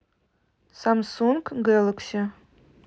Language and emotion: Russian, neutral